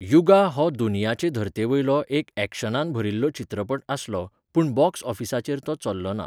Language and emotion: Goan Konkani, neutral